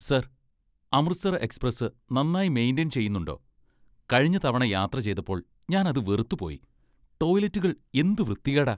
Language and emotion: Malayalam, disgusted